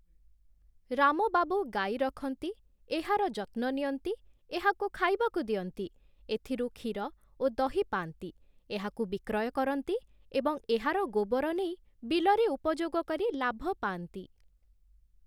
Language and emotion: Odia, neutral